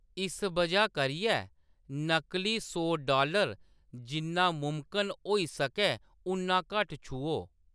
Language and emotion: Dogri, neutral